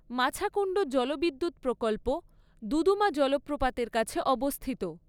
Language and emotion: Bengali, neutral